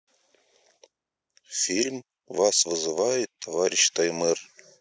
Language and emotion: Russian, neutral